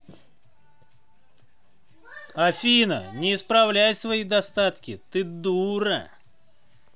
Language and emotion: Russian, angry